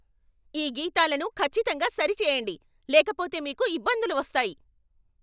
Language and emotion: Telugu, angry